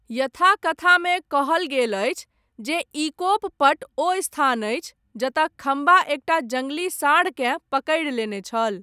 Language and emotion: Maithili, neutral